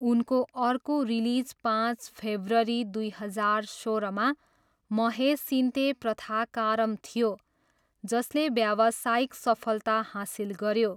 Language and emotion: Nepali, neutral